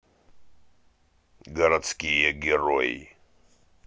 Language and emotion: Russian, neutral